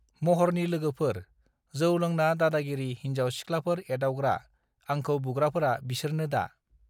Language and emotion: Bodo, neutral